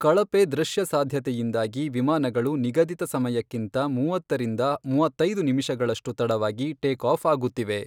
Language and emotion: Kannada, neutral